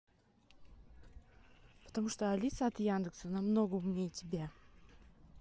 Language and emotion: Russian, angry